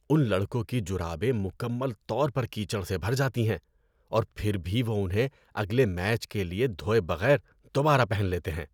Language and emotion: Urdu, disgusted